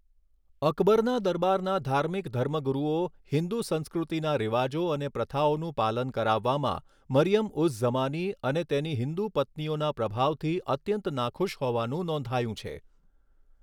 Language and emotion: Gujarati, neutral